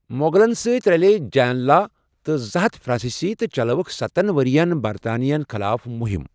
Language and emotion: Kashmiri, neutral